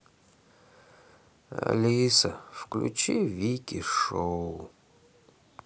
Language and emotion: Russian, sad